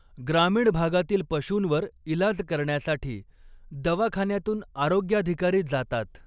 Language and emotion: Marathi, neutral